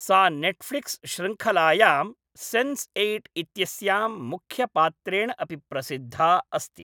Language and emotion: Sanskrit, neutral